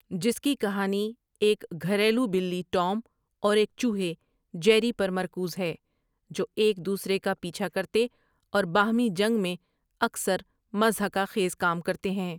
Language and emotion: Urdu, neutral